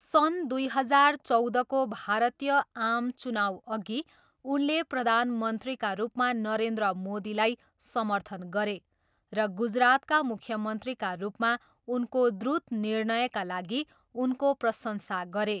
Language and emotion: Nepali, neutral